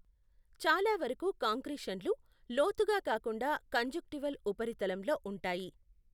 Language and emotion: Telugu, neutral